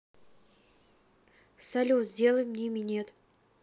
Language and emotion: Russian, neutral